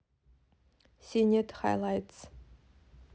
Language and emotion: Russian, neutral